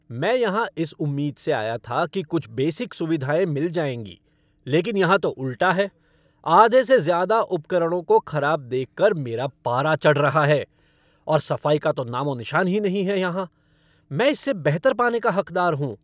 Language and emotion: Hindi, angry